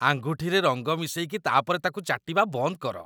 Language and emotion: Odia, disgusted